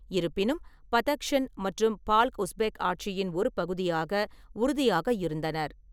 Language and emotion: Tamil, neutral